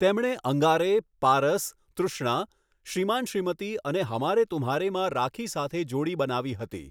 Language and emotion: Gujarati, neutral